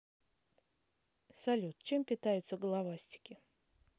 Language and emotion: Russian, neutral